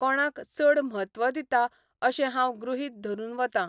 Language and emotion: Goan Konkani, neutral